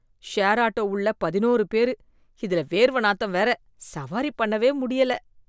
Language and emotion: Tamil, disgusted